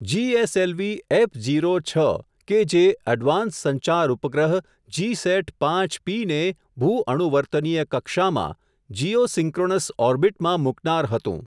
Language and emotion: Gujarati, neutral